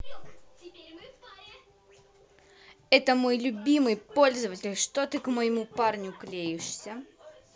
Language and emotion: Russian, angry